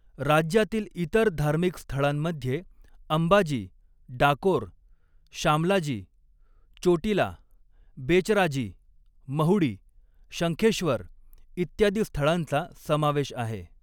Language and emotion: Marathi, neutral